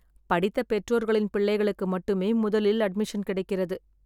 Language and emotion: Tamil, sad